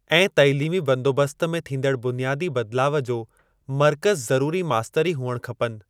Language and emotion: Sindhi, neutral